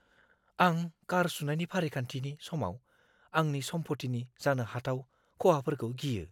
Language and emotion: Bodo, fearful